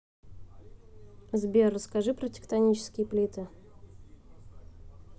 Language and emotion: Russian, neutral